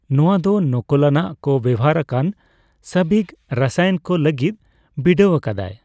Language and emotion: Santali, neutral